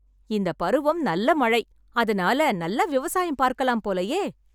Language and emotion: Tamil, happy